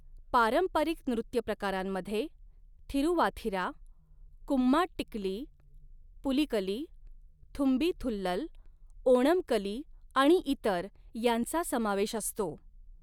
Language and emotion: Marathi, neutral